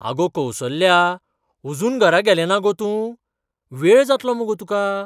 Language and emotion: Goan Konkani, surprised